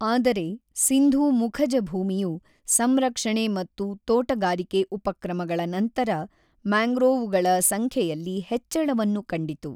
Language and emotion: Kannada, neutral